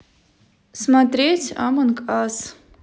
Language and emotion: Russian, neutral